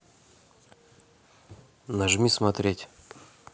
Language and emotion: Russian, neutral